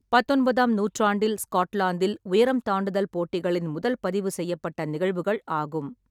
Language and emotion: Tamil, neutral